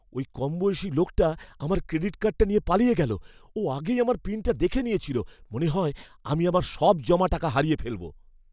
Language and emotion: Bengali, fearful